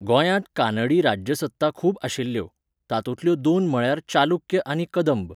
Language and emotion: Goan Konkani, neutral